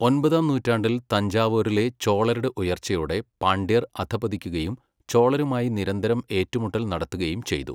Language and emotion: Malayalam, neutral